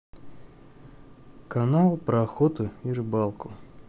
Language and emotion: Russian, neutral